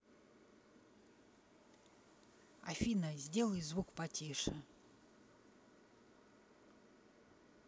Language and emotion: Russian, neutral